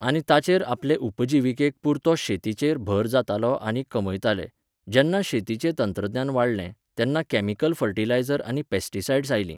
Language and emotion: Goan Konkani, neutral